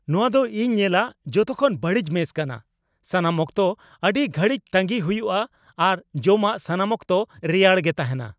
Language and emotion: Santali, angry